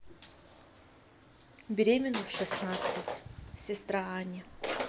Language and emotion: Russian, neutral